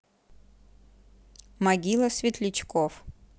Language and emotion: Russian, neutral